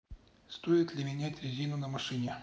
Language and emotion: Russian, neutral